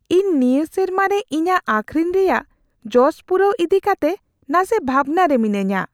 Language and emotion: Santali, fearful